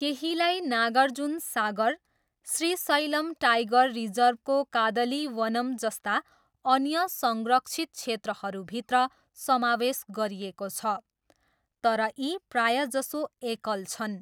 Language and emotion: Nepali, neutral